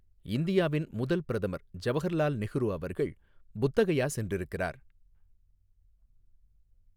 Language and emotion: Tamil, neutral